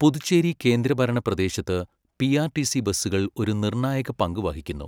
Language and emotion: Malayalam, neutral